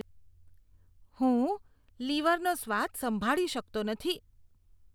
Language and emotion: Gujarati, disgusted